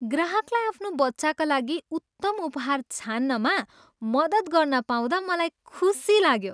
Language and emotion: Nepali, happy